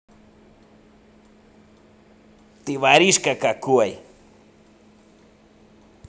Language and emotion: Russian, angry